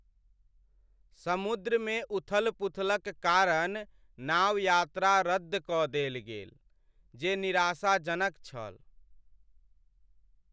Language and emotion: Maithili, sad